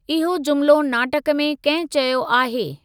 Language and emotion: Sindhi, neutral